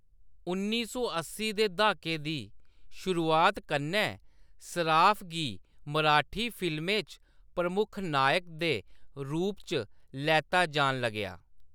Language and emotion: Dogri, neutral